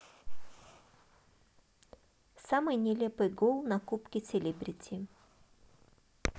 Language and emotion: Russian, neutral